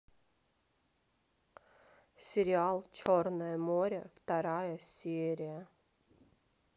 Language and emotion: Russian, sad